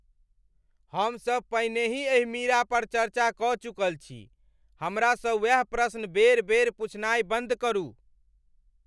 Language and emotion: Maithili, angry